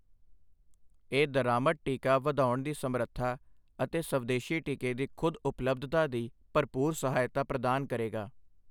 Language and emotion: Punjabi, neutral